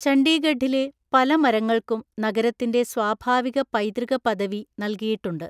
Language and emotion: Malayalam, neutral